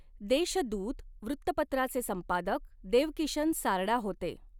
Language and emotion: Marathi, neutral